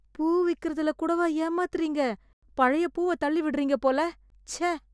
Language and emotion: Tamil, disgusted